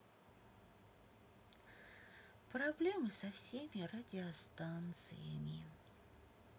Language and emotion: Russian, sad